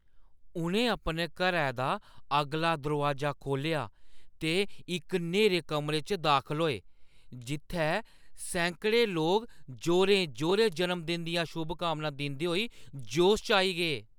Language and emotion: Dogri, surprised